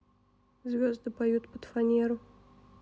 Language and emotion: Russian, sad